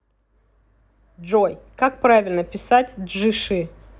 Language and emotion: Russian, neutral